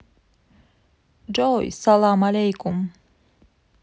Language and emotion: Russian, positive